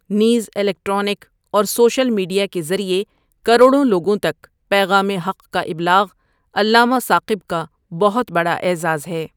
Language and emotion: Urdu, neutral